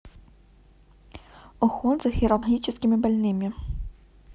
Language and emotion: Russian, neutral